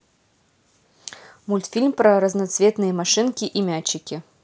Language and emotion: Russian, neutral